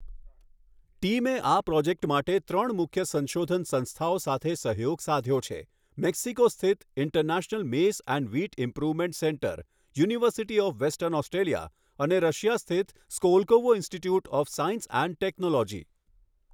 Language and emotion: Gujarati, neutral